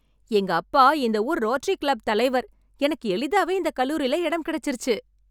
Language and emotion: Tamil, happy